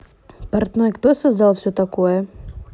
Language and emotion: Russian, neutral